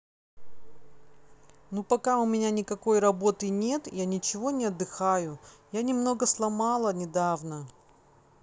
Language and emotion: Russian, sad